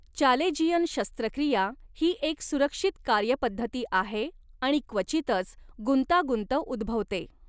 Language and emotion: Marathi, neutral